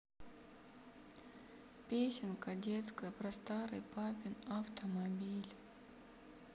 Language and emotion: Russian, sad